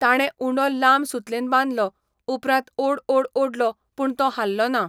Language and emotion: Goan Konkani, neutral